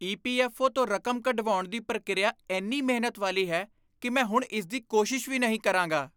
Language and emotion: Punjabi, disgusted